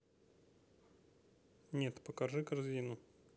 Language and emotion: Russian, neutral